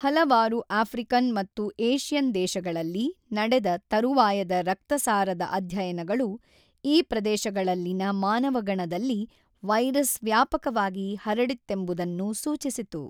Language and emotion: Kannada, neutral